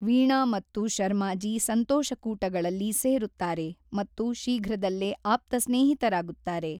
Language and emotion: Kannada, neutral